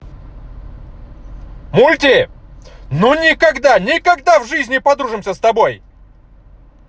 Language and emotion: Russian, angry